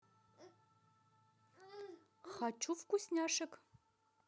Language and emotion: Russian, positive